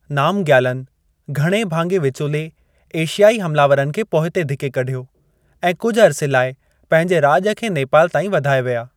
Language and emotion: Sindhi, neutral